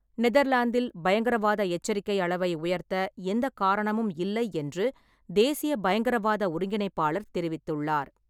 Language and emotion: Tamil, neutral